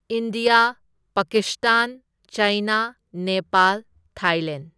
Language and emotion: Manipuri, neutral